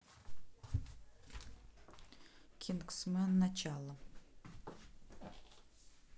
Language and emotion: Russian, neutral